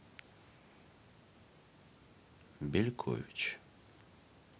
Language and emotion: Russian, neutral